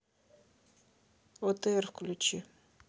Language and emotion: Russian, neutral